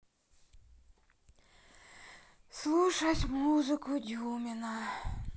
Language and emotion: Russian, sad